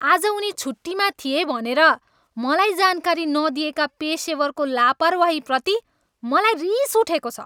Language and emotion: Nepali, angry